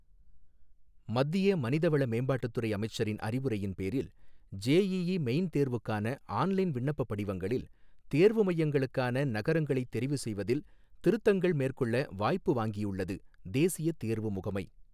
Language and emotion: Tamil, neutral